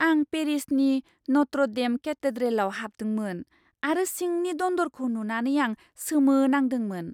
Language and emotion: Bodo, surprised